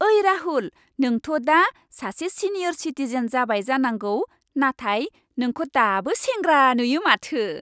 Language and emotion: Bodo, happy